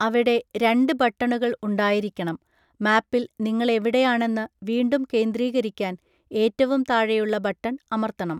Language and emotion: Malayalam, neutral